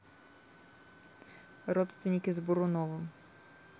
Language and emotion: Russian, neutral